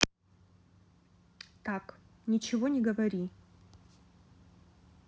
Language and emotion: Russian, neutral